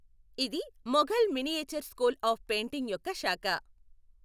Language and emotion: Telugu, neutral